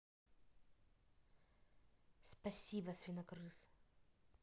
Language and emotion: Russian, neutral